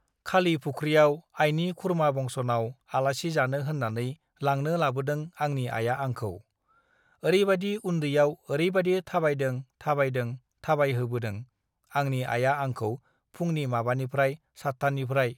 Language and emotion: Bodo, neutral